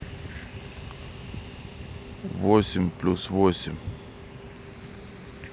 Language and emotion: Russian, neutral